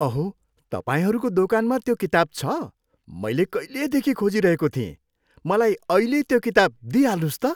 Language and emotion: Nepali, happy